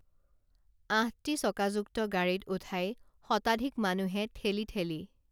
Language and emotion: Assamese, neutral